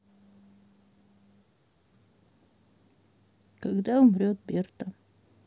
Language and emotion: Russian, sad